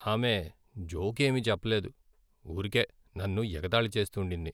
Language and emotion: Telugu, sad